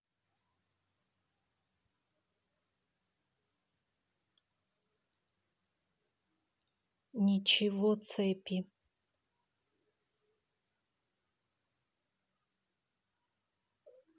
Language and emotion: Russian, neutral